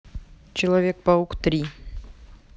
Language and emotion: Russian, neutral